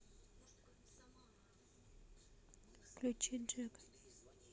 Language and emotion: Russian, neutral